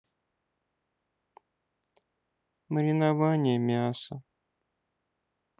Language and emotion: Russian, sad